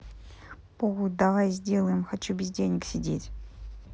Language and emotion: Russian, neutral